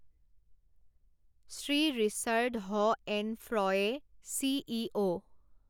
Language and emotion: Assamese, neutral